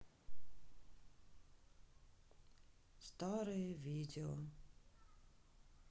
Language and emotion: Russian, sad